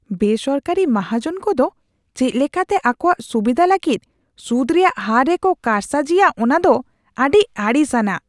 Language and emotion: Santali, disgusted